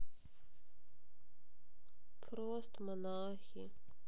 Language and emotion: Russian, sad